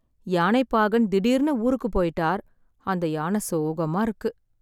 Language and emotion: Tamil, sad